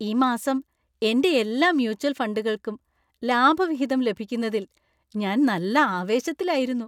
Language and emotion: Malayalam, happy